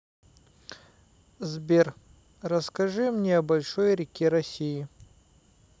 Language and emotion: Russian, neutral